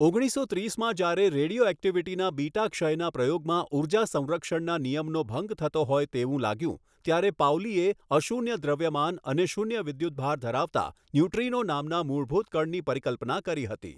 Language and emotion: Gujarati, neutral